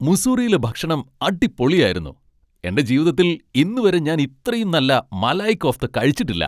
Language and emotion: Malayalam, happy